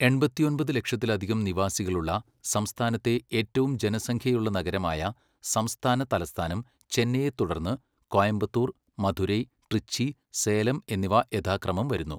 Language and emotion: Malayalam, neutral